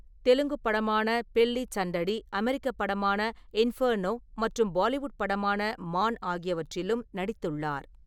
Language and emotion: Tamil, neutral